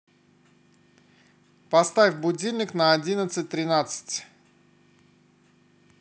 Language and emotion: Russian, neutral